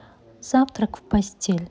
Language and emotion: Russian, neutral